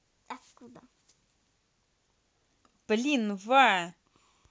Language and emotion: Russian, angry